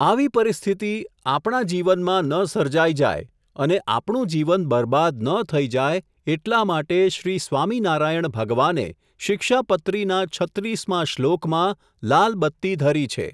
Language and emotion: Gujarati, neutral